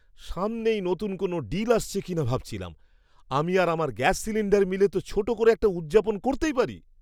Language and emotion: Bengali, surprised